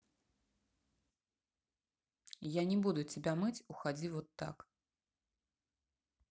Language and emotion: Russian, neutral